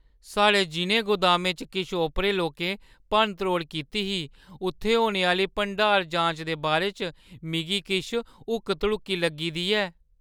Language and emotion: Dogri, fearful